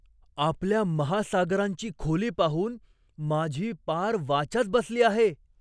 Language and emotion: Marathi, surprised